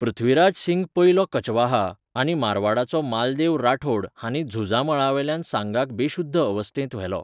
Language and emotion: Goan Konkani, neutral